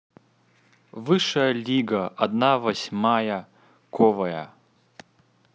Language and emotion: Russian, neutral